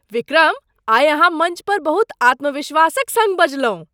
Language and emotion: Maithili, surprised